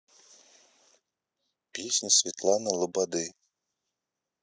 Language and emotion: Russian, neutral